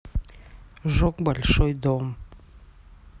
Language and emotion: Russian, neutral